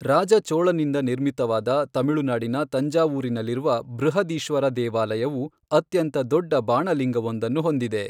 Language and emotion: Kannada, neutral